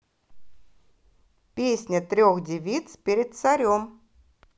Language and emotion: Russian, positive